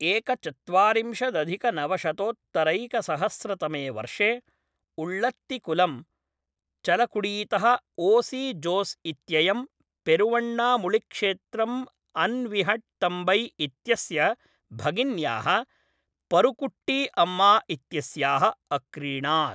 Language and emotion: Sanskrit, neutral